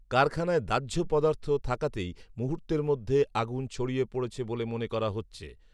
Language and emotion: Bengali, neutral